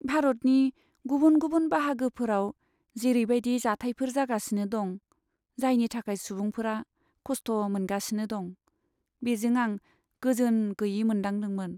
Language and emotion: Bodo, sad